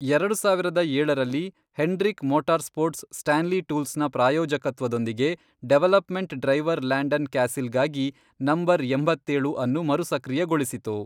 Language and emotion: Kannada, neutral